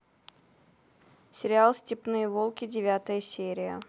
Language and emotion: Russian, neutral